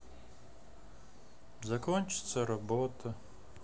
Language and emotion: Russian, sad